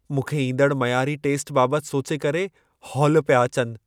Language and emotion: Sindhi, fearful